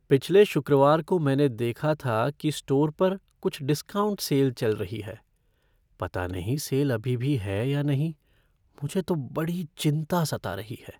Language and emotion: Hindi, fearful